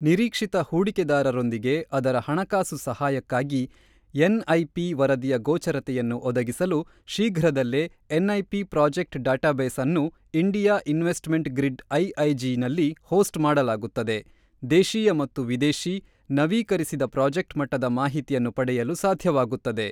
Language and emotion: Kannada, neutral